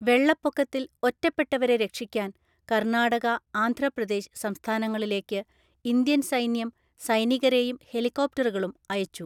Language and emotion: Malayalam, neutral